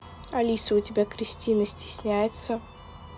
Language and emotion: Russian, neutral